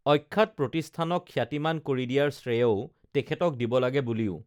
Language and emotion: Assamese, neutral